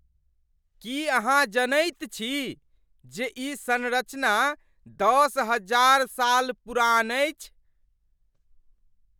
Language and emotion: Maithili, surprised